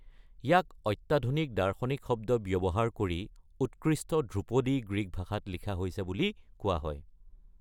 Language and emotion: Assamese, neutral